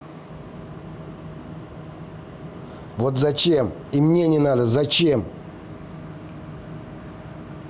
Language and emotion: Russian, angry